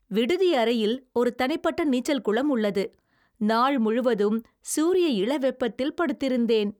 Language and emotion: Tamil, happy